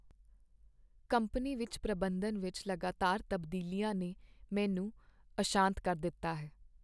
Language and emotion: Punjabi, sad